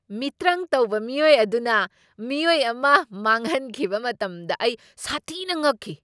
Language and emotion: Manipuri, surprised